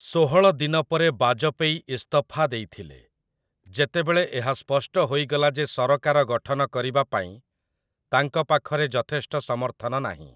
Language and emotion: Odia, neutral